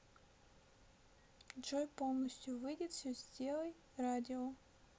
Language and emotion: Russian, neutral